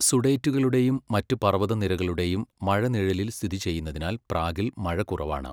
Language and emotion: Malayalam, neutral